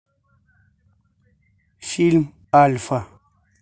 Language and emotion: Russian, neutral